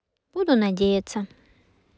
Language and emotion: Russian, neutral